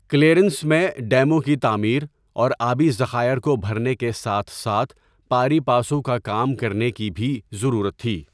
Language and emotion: Urdu, neutral